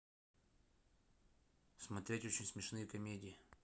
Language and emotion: Russian, neutral